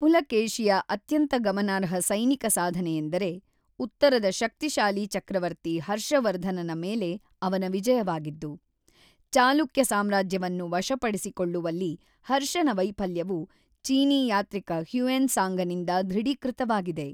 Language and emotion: Kannada, neutral